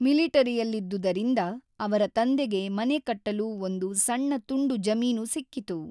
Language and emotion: Kannada, neutral